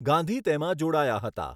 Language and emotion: Gujarati, neutral